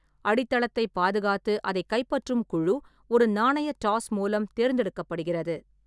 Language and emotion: Tamil, neutral